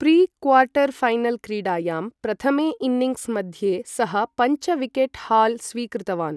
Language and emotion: Sanskrit, neutral